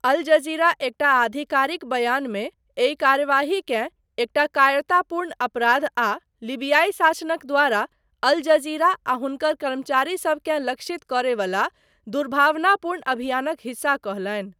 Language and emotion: Maithili, neutral